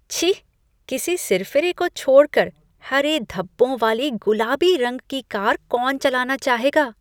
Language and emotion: Hindi, disgusted